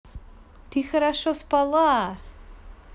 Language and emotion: Russian, positive